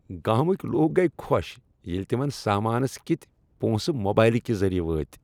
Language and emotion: Kashmiri, happy